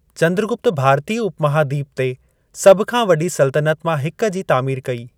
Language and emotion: Sindhi, neutral